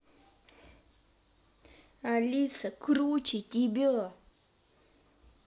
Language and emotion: Russian, angry